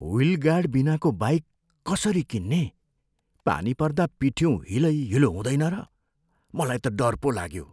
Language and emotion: Nepali, fearful